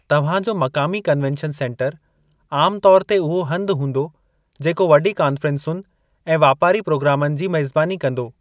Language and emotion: Sindhi, neutral